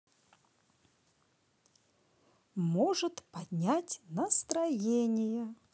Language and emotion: Russian, positive